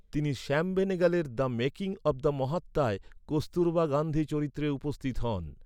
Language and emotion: Bengali, neutral